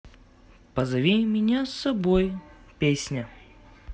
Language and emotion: Russian, positive